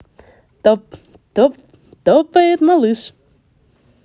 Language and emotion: Russian, positive